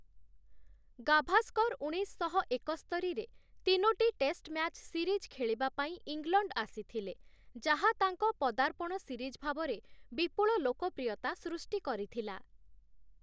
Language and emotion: Odia, neutral